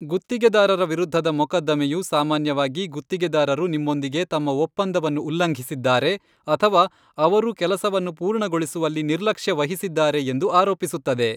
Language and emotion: Kannada, neutral